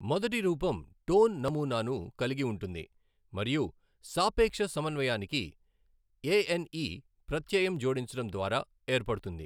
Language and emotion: Telugu, neutral